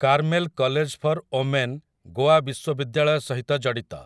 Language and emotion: Odia, neutral